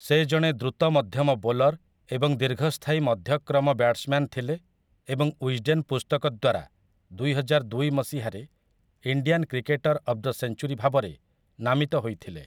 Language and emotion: Odia, neutral